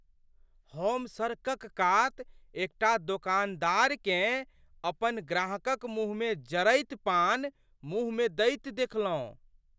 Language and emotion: Maithili, surprised